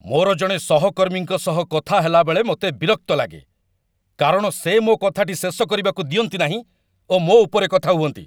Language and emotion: Odia, angry